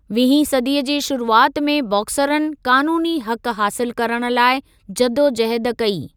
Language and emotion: Sindhi, neutral